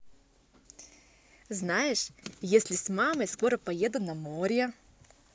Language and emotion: Russian, positive